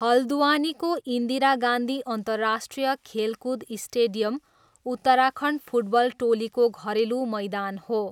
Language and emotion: Nepali, neutral